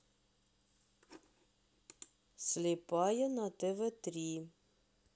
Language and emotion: Russian, neutral